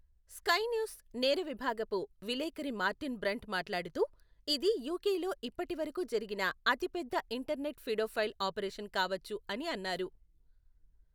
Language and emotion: Telugu, neutral